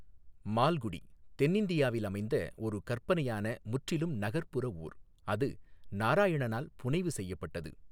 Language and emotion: Tamil, neutral